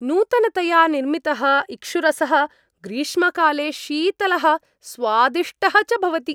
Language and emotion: Sanskrit, happy